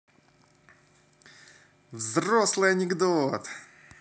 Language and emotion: Russian, positive